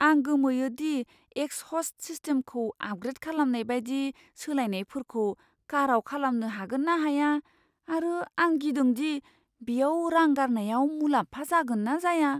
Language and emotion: Bodo, fearful